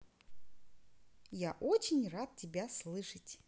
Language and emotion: Russian, positive